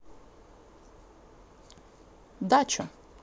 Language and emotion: Russian, neutral